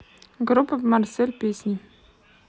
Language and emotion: Russian, neutral